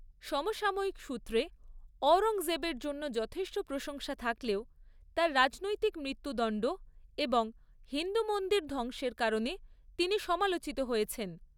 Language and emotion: Bengali, neutral